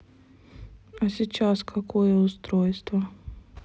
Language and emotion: Russian, neutral